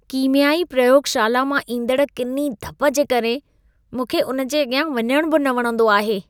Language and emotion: Sindhi, disgusted